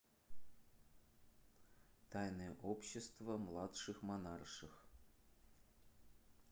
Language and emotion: Russian, neutral